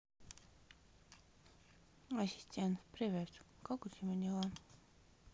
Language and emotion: Russian, sad